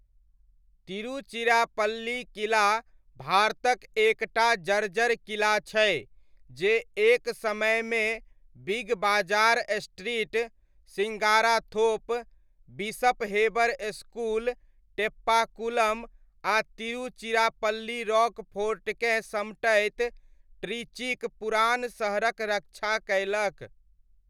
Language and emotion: Maithili, neutral